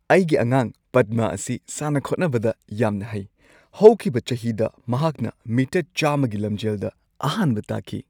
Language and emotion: Manipuri, happy